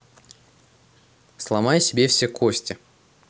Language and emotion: Russian, positive